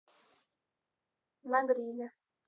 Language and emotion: Russian, neutral